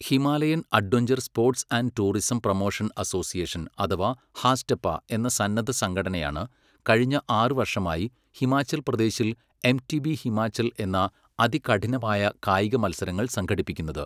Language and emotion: Malayalam, neutral